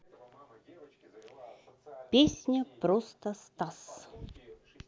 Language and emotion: Russian, positive